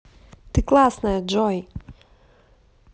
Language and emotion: Russian, positive